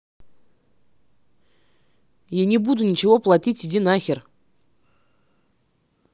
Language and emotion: Russian, angry